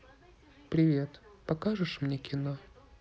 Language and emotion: Russian, sad